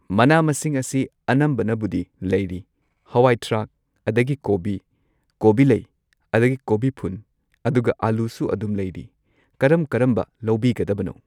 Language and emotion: Manipuri, neutral